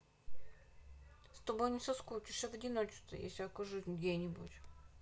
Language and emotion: Russian, sad